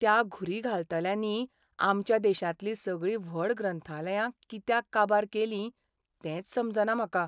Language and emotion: Goan Konkani, sad